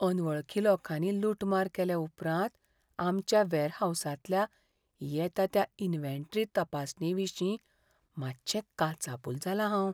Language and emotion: Goan Konkani, fearful